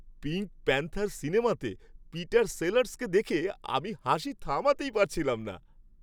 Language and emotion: Bengali, happy